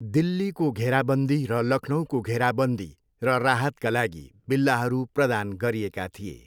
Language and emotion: Nepali, neutral